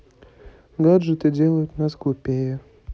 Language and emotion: Russian, sad